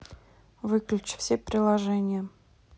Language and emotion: Russian, neutral